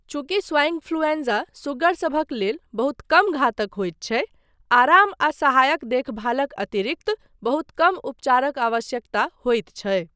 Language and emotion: Maithili, neutral